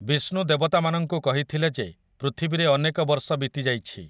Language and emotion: Odia, neutral